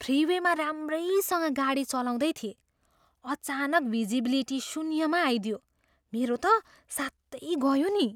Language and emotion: Nepali, surprised